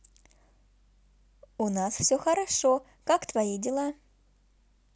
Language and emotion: Russian, positive